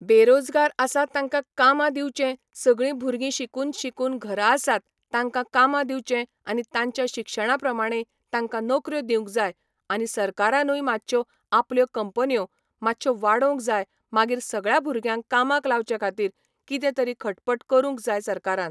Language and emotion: Goan Konkani, neutral